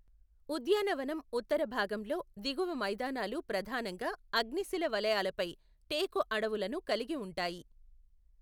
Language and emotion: Telugu, neutral